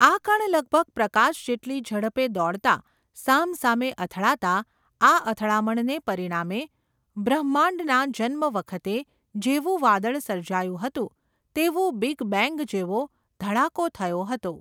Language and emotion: Gujarati, neutral